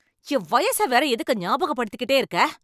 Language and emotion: Tamil, angry